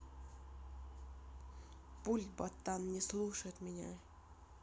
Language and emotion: Russian, neutral